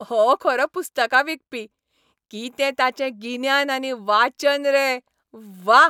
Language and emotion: Goan Konkani, happy